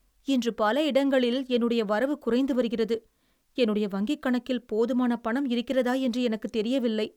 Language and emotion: Tamil, sad